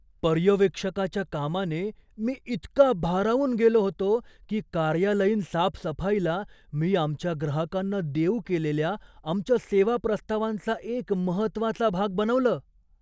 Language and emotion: Marathi, surprised